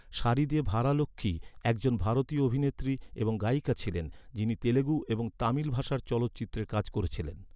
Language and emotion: Bengali, neutral